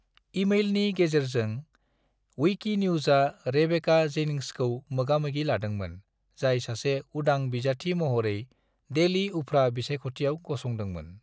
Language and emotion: Bodo, neutral